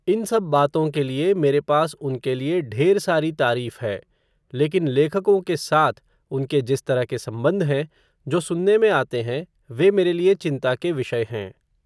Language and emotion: Hindi, neutral